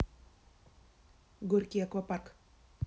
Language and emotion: Russian, neutral